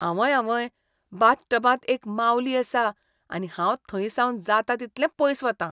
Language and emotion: Goan Konkani, disgusted